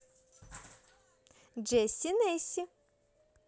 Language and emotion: Russian, positive